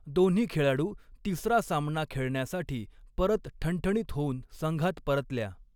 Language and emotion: Marathi, neutral